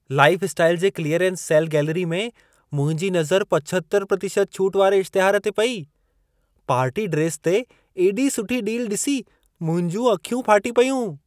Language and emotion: Sindhi, surprised